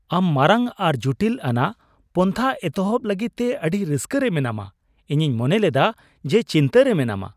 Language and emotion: Santali, surprised